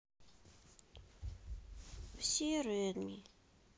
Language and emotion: Russian, sad